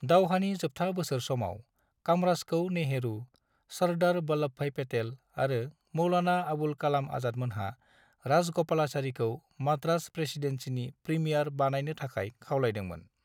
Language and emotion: Bodo, neutral